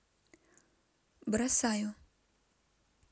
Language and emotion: Russian, neutral